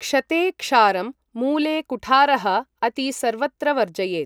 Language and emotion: Sanskrit, neutral